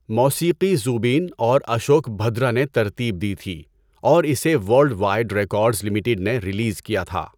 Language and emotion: Urdu, neutral